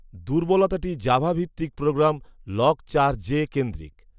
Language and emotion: Bengali, neutral